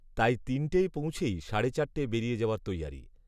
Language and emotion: Bengali, neutral